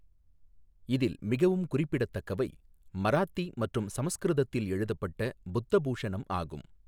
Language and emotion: Tamil, neutral